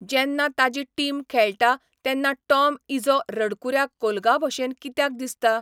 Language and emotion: Goan Konkani, neutral